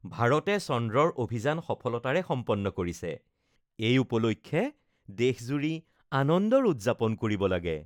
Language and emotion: Assamese, happy